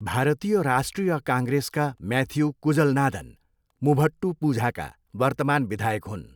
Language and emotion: Nepali, neutral